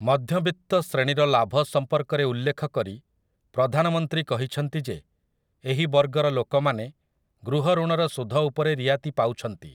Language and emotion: Odia, neutral